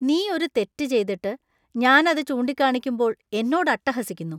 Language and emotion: Malayalam, disgusted